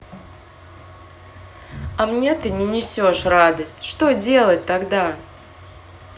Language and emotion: Russian, neutral